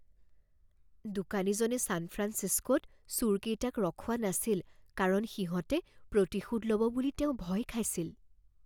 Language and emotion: Assamese, fearful